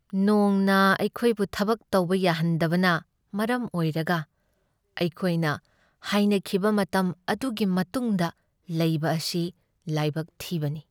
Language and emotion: Manipuri, sad